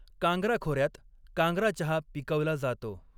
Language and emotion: Marathi, neutral